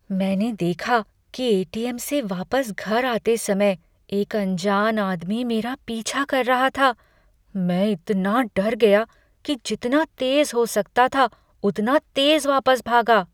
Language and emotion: Hindi, fearful